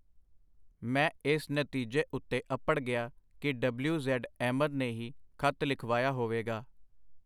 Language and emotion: Punjabi, neutral